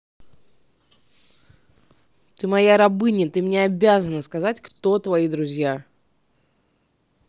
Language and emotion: Russian, angry